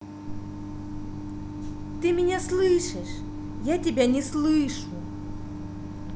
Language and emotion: Russian, angry